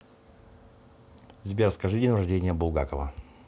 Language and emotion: Russian, neutral